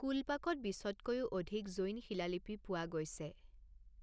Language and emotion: Assamese, neutral